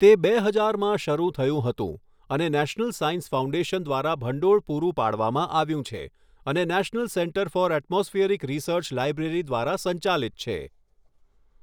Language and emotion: Gujarati, neutral